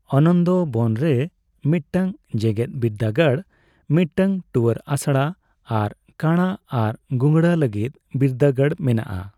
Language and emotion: Santali, neutral